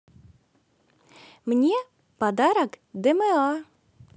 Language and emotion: Russian, positive